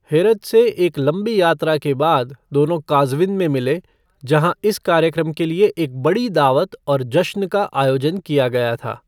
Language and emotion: Hindi, neutral